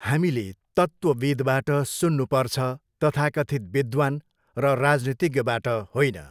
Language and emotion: Nepali, neutral